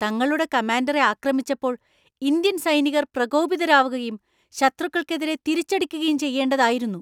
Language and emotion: Malayalam, angry